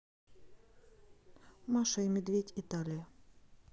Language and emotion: Russian, neutral